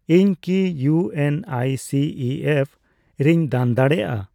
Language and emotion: Santali, neutral